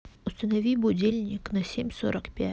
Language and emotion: Russian, neutral